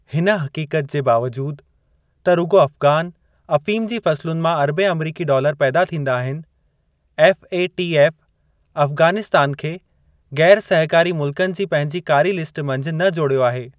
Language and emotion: Sindhi, neutral